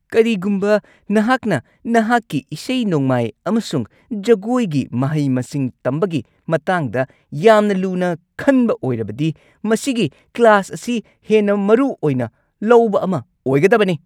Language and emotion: Manipuri, angry